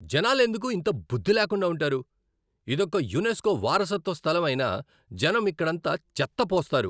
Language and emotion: Telugu, angry